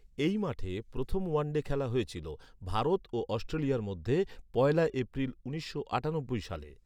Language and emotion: Bengali, neutral